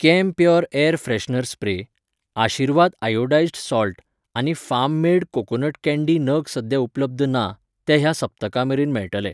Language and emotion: Goan Konkani, neutral